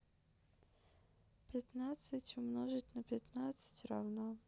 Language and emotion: Russian, sad